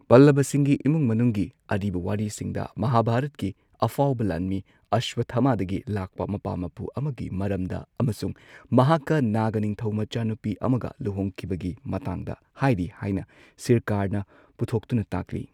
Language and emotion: Manipuri, neutral